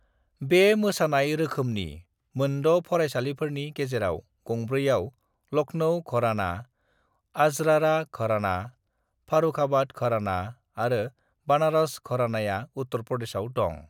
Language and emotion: Bodo, neutral